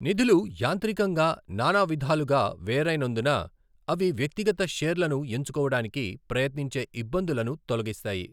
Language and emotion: Telugu, neutral